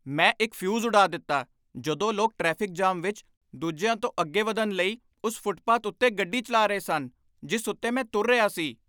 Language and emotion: Punjabi, angry